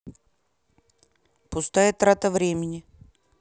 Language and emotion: Russian, neutral